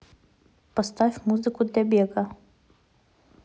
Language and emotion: Russian, neutral